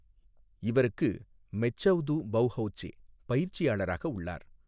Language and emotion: Tamil, neutral